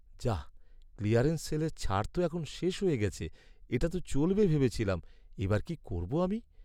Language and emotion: Bengali, sad